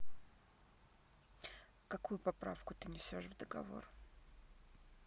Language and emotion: Russian, neutral